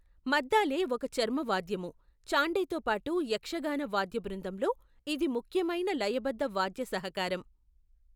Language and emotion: Telugu, neutral